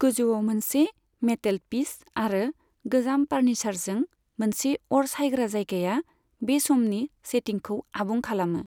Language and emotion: Bodo, neutral